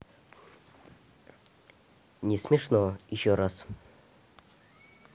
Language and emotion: Russian, neutral